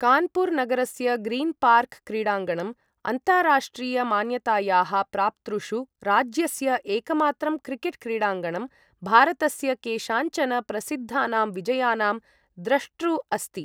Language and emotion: Sanskrit, neutral